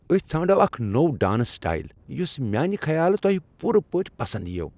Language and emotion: Kashmiri, happy